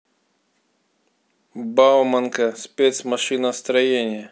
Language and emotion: Russian, neutral